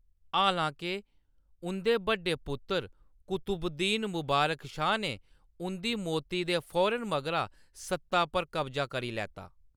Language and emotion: Dogri, neutral